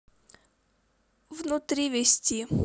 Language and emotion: Russian, sad